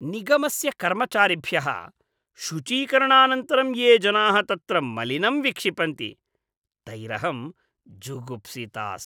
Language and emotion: Sanskrit, disgusted